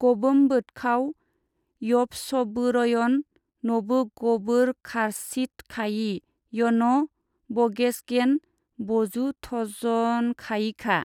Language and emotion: Bodo, neutral